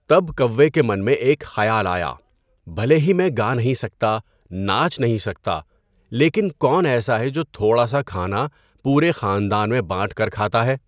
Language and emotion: Urdu, neutral